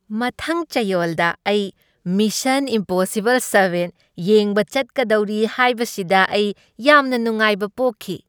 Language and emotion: Manipuri, happy